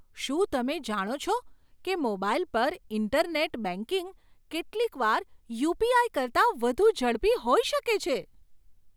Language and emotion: Gujarati, surprised